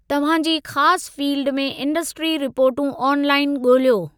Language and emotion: Sindhi, neutral